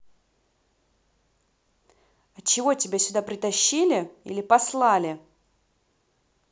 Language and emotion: Russian, angry